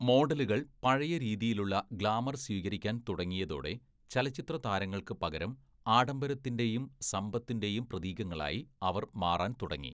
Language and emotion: Malayalam, neutral